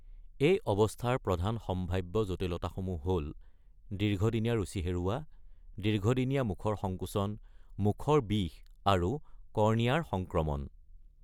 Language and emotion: Assamese, neutral